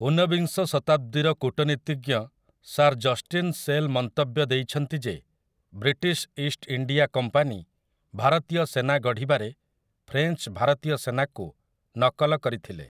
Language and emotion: Odia, neutral